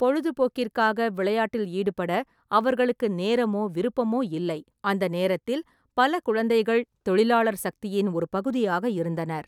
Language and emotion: Tamil, neutral